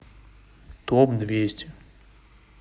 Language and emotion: Russian, neutral